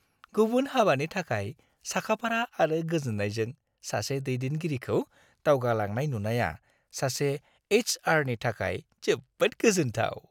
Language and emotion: Bodo, happy